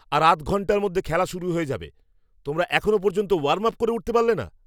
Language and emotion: Bengali, angry